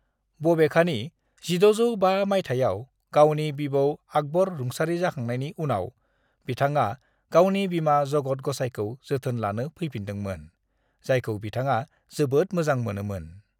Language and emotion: Bodo, neutral